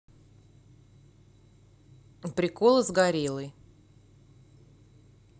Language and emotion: Russian, neutral